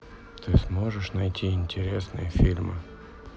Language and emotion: Russian, sad